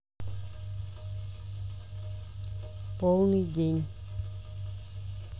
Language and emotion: Russian, neutral